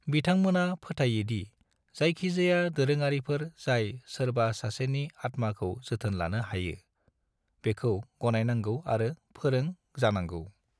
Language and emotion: Bodo, neutral